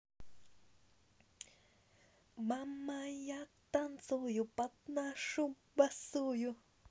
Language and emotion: Russian, positive